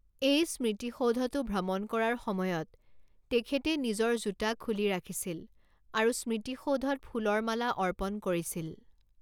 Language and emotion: Assamese, neutral